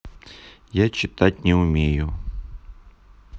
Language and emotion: Russian, neutral